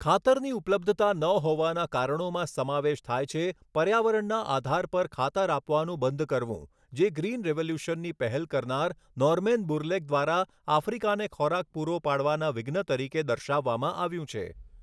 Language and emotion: Gujarati, neutral